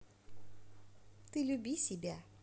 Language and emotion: Russian, neutral